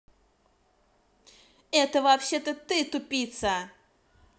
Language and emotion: Russian, angry